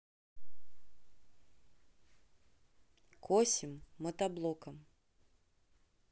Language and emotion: Russian, neutral